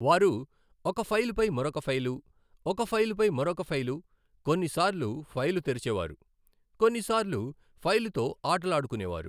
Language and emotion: Telugu, neutral